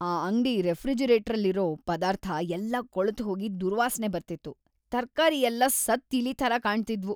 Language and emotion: Kannada, disgusted